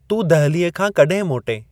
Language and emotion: Sindhi, neutral